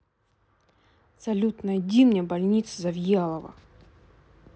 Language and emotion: Russian, angry